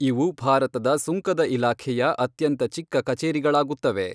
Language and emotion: Kannada, neutral